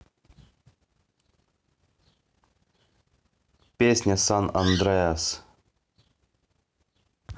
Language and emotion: Russian, neutral